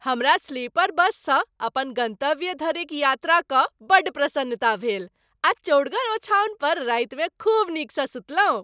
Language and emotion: Maithili, happy